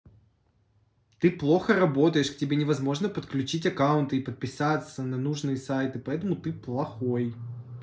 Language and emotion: Russian, angry